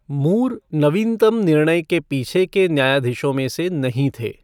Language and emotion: Hindi, neutral